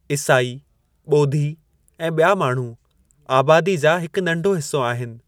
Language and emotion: Sindhi, neutral